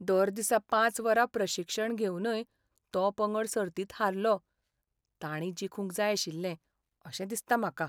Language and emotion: Goan Konkani, sad